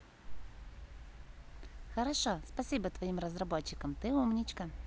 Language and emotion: Russian, positive